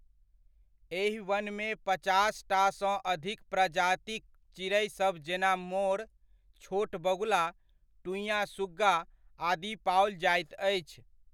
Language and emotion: Maithili, neutral